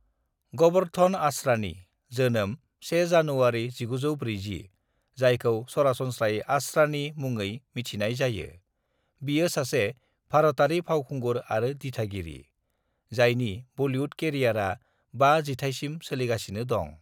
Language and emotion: Bodo, neutral